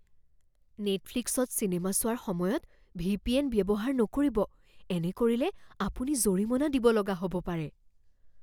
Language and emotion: Assamese, fearful